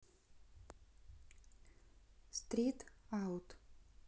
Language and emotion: Russian, neutral